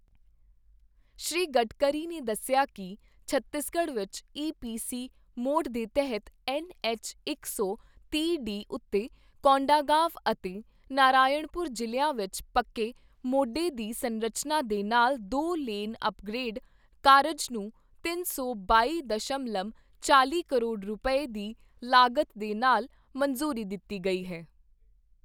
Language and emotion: Punjabi, neutral